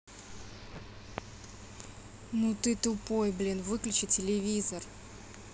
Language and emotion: Russian, angry